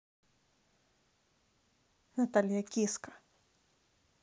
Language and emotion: Russian, neutral